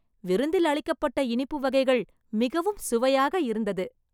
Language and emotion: Tamil, happy